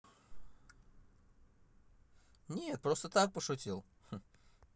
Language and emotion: Russian, positive